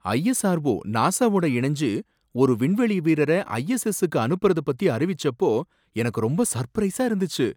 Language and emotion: Tamil, surprised